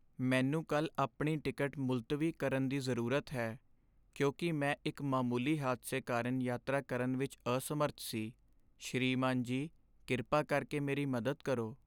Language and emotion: Punjabi, sad